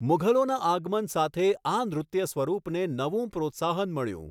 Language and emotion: Gujarati, neutral